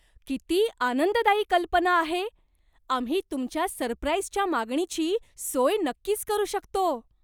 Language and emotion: Marathi, surprised